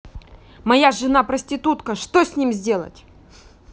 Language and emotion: Russian, angry